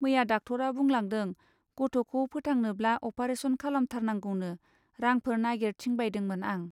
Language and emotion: Bodo, neutral